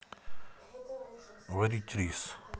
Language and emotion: Russian, neutral